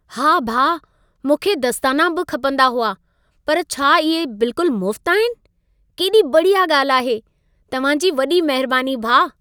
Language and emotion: Sindhi, happy